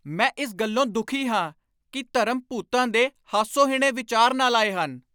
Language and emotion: Punjabi, angry